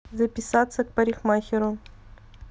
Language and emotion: Russian, neutral